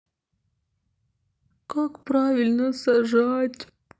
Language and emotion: Russian, sad